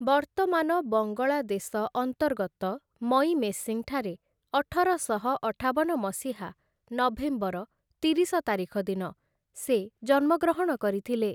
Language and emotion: Odia, neutral